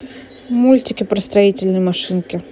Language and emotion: Russian, neutral